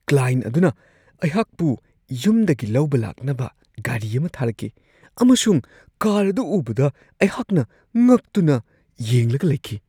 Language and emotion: Manipuri, surprised